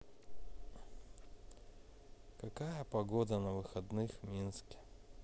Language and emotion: Russian, sad